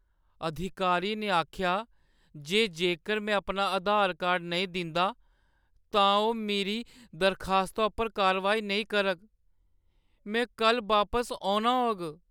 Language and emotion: Dogri, sad